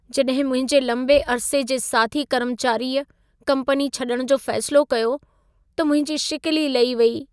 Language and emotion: Sindhi, sad